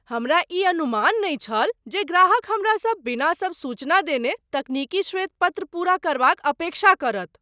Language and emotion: Maithili, surprised